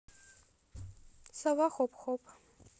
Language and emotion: Russian, neutral